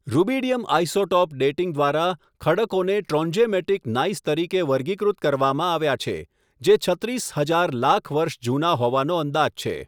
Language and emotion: Gujarati, neutral